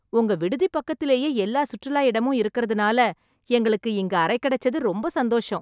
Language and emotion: Tamil, happy